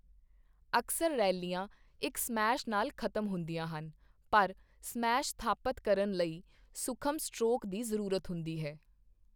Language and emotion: Punjabi, neutral